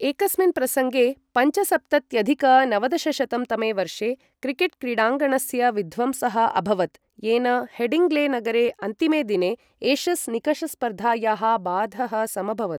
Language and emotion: Sanskrit, neutral